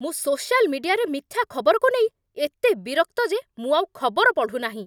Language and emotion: Odia, angry